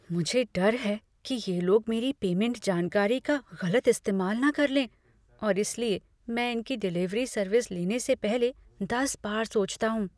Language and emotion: Hindi, fearful